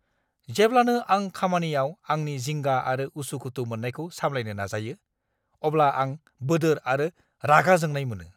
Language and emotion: Bodo, angry